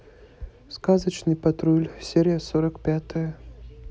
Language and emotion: Russian, neutral